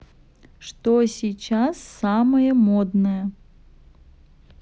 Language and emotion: Russian, neutral